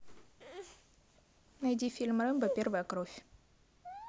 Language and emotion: Russian, neutral